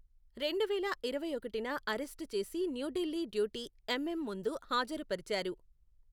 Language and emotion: Telugu, neutral